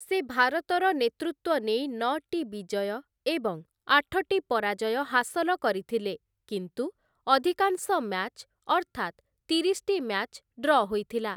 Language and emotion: Odia, neutral